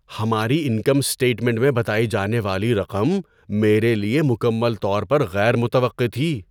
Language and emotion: Urdu, surprised